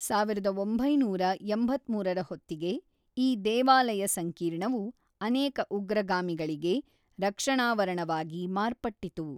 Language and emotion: Kannada, neutral